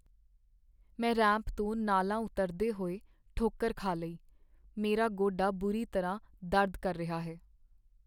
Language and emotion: Punjabi, sad